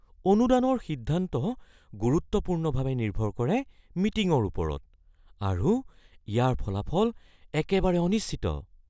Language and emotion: Assamese, fearful